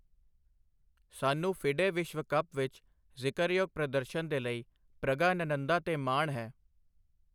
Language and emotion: Punjabi, neutral